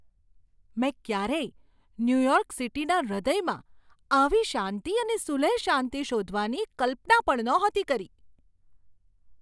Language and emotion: Gujarati, surprised